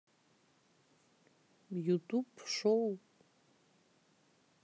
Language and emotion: Russian, neutral